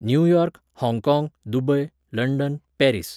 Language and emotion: Goan Konkani, neutral